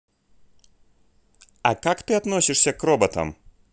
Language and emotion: Russian, neutral